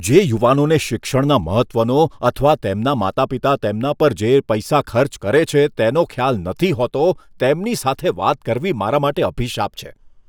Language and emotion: Gujarati, disgusted